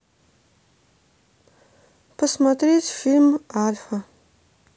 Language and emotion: Russian, neutral